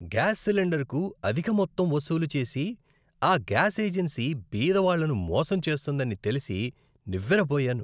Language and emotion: Telugu, disgusted